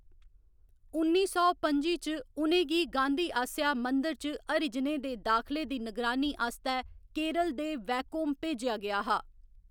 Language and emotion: Dogri, neutral